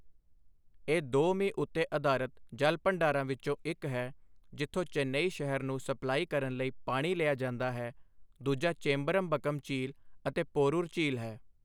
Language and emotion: Punjabi, neutral